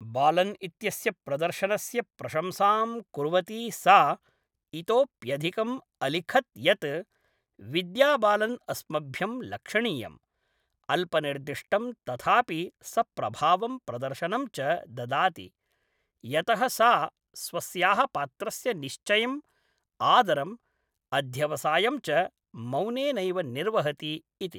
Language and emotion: Sanskrit, neutral